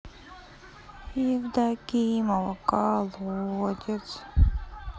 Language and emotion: Russian, sad